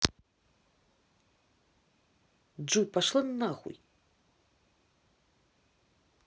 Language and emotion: Russian, angry